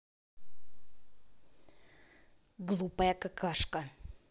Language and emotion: Russian, angry